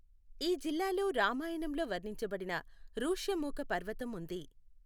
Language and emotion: Telugu, neutral